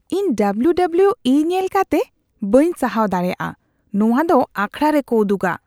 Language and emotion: Santali, disgusted